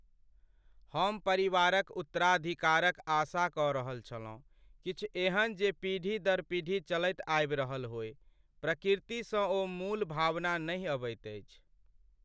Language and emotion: Maithili, sad